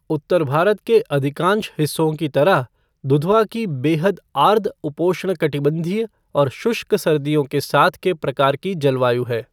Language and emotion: Hindi, neutral